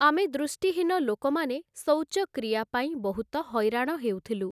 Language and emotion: Odia, neutral